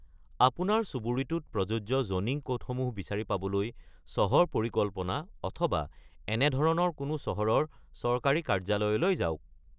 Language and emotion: Assamese, neutral